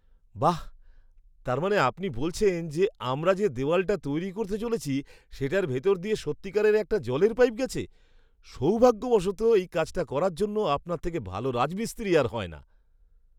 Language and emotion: Bengali, surprised